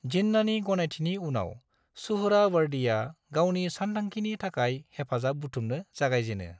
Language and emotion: Bodo, neutral